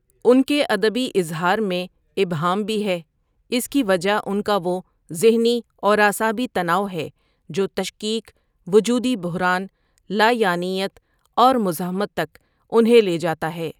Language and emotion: Urdu, neutral